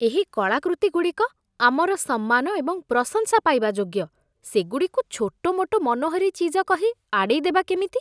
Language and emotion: Odia, disgusted